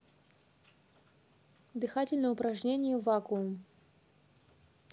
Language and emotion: Russian, neutral